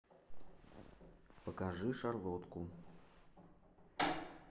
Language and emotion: Russian, neutral